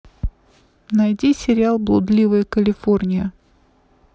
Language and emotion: Russian, neutral